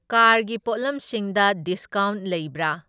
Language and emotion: Manipuri, neutral